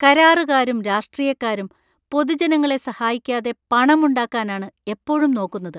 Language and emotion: Malayalam, disgusted